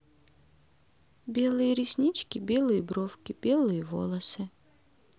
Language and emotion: Russian, neutral